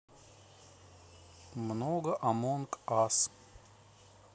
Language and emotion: Russian, neutral